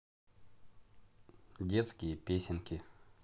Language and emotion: Russian, neutral